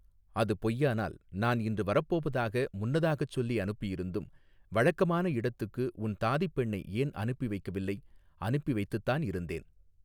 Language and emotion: Tamil, neutral